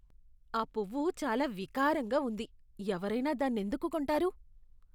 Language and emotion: Telugu, disgusted